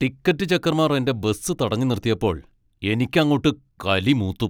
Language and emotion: Malayalam, angry